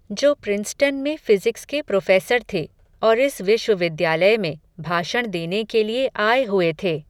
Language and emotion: Hindi, neutral